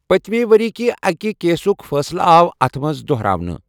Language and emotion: Kashmiri, neutral